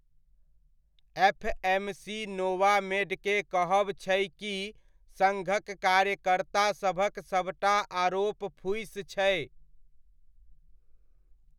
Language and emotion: Maithili, neutral